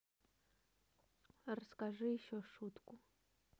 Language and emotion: Russian, neutral